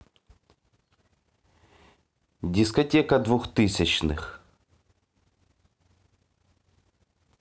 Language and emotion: Russian, neutral